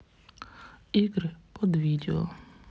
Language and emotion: Russian, neutral